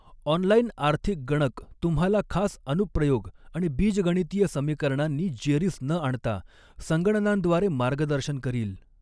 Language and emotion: Marathi, neutral